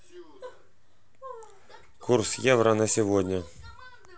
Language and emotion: Russian, neutral